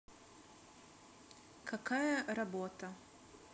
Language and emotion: Russian, neutral